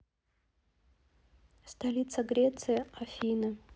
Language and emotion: Russian, neutral